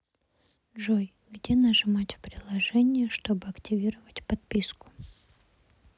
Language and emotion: Russian, neutral